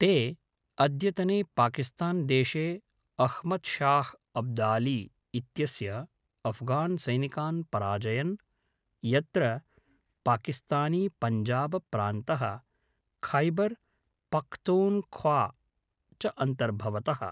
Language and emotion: Sanskrit, neutral